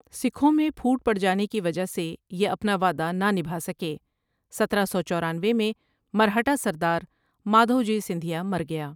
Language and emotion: Urdu, neutral